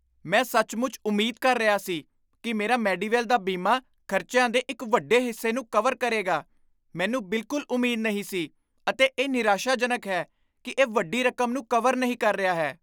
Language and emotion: Punjabi, surprised